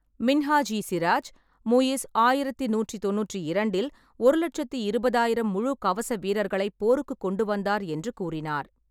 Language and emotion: Tamil, neutral